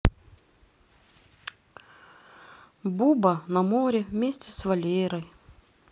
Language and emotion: Russian, sad